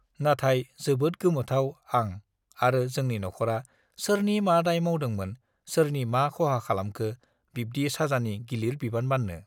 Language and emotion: Bodo, neutral